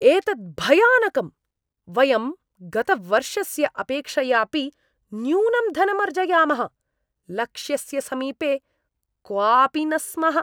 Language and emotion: Sanskrit, disgusted